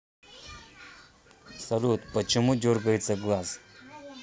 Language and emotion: Russian, neutral